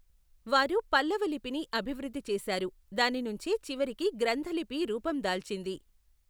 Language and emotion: Telugu, neutral